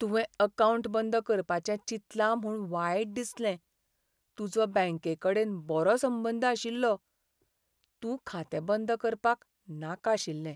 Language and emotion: Goan Konkani, sad